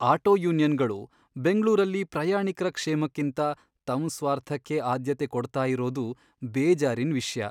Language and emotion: Kannada, sad